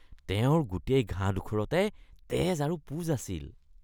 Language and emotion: Assamese, disgusted